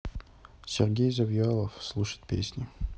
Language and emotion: Russian, neutral